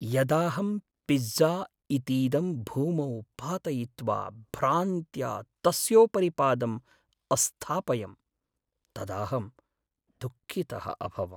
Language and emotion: Sanskrit, sad